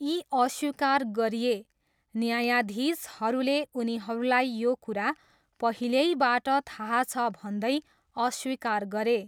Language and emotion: Nepali, neutral